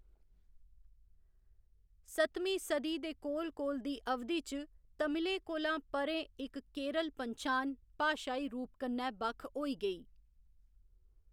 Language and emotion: Dogri, neutral